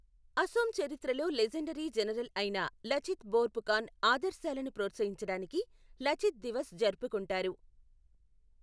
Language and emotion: Telugu, neutral